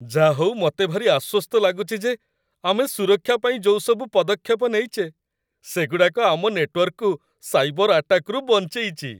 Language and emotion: Odia, happy